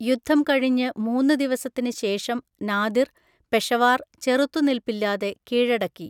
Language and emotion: Malayalam, neutral